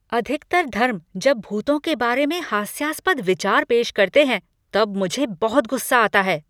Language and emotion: Hindi, angry